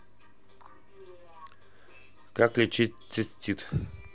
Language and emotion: Russian, neutral